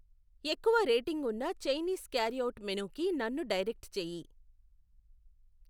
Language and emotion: Telugu, neutral